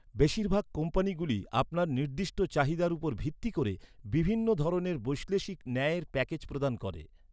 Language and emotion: Bengali, neutral